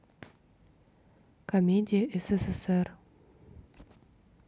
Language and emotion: Russian, neutral